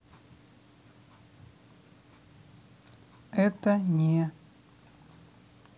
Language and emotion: Russian, neutral